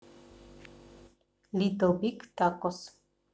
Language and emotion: Russian, neutral